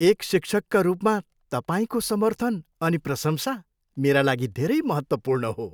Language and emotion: Nepali, happy